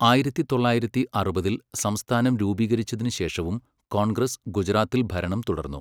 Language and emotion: Malayalam, neutral